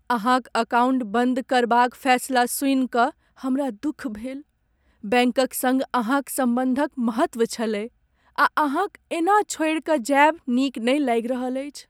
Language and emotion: Maithili, sad